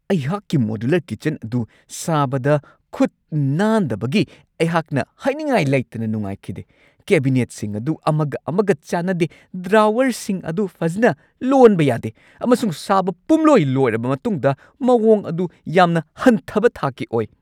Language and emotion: Manipuri, angry